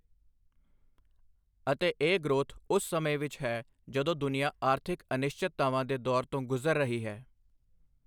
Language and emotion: Punjabi, neutral